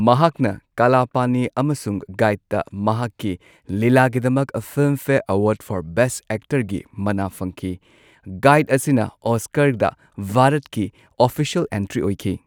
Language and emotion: Manipuri, neutral